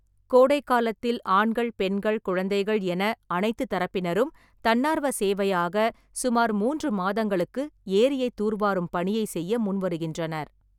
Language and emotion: Tamil, neutral